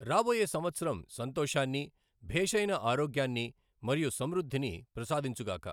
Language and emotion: Telugu, neutral